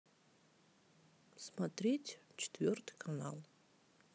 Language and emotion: Russian, sad